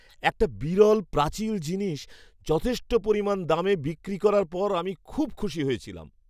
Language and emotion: Bengali, happy